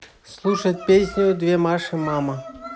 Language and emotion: Russian, positive